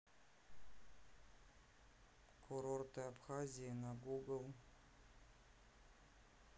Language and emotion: Russian, neutral